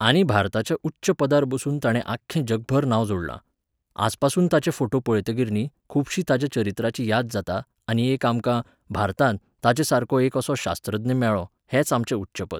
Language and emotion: Goan Konkani, neutral